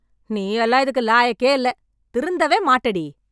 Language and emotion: Tamil, angry